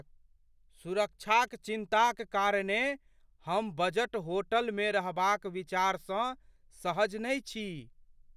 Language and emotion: Maithili, fearful